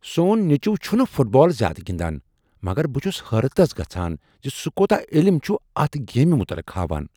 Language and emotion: Kashmiri, surprised